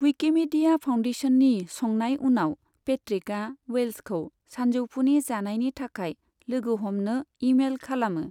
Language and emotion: Bodo, neutral